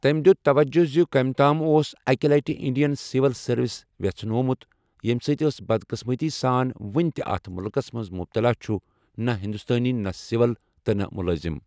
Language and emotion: Kashmiri, neutral